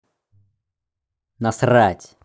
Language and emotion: Russian, angry